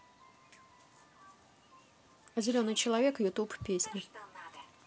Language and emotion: Russian, neutral